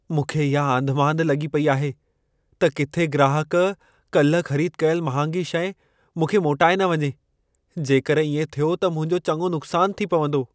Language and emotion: Sindhi, fearful